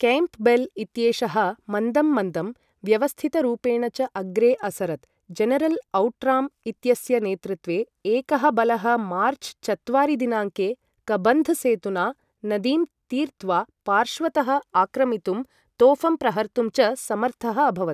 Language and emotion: Sanskrit, neutral